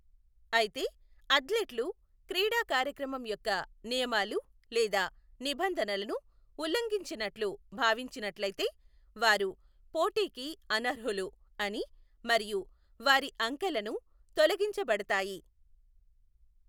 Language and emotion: Telugu, neutral